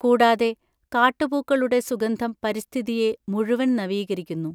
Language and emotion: Malayalam, neutral